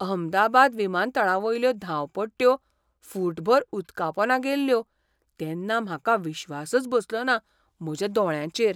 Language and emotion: Goan Konkani, surprised